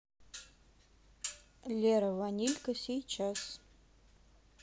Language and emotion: Russian, neutral